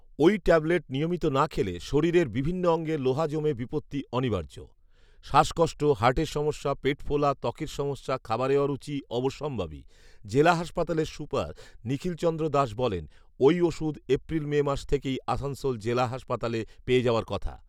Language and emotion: Bengali, neutral